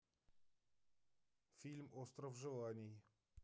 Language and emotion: Russian, neutral